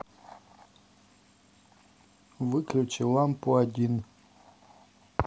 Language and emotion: Russian, neutral